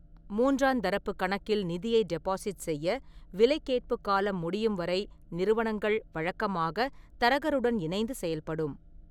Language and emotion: Tamil, neutral